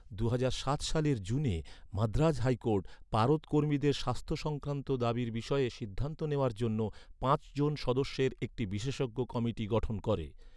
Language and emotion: Bengali, neutral